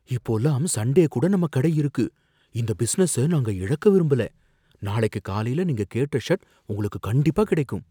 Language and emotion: Tamil, fearful